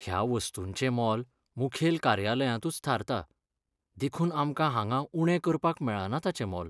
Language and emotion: Goan Konkani, sad